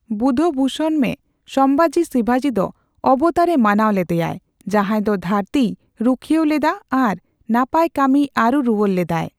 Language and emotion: Santali, neutral